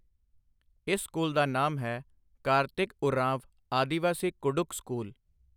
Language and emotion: Punjabi, neutral